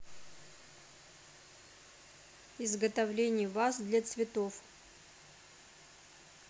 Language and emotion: Russian, neutral